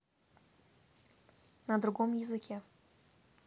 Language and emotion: Russian, neutral